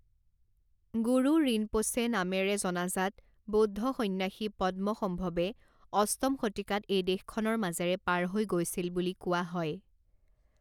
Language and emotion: Assamese, neutral